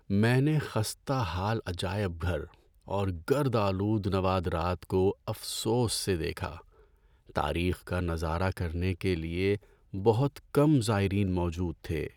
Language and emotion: Urdu, sad